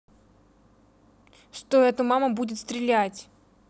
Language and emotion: Russian, angry